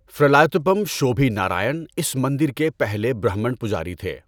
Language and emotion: Urdu, neutral